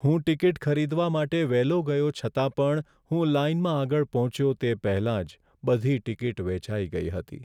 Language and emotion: Gujarati, sad